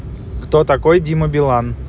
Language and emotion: Russian, neutral